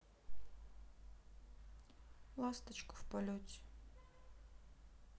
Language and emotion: Russian, sad